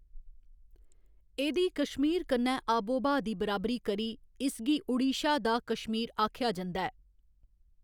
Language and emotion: Dogri, neutral